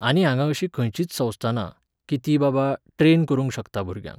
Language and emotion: Goan Konkani, neutral